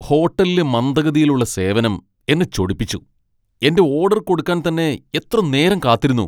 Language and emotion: Malayalam, angry